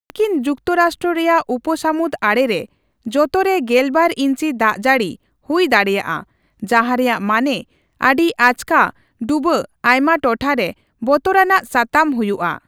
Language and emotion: Santali, neutral